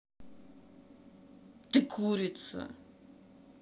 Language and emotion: Russian, angry